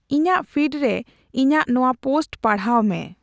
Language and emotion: Santali, neutral